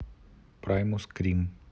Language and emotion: Russian, neutral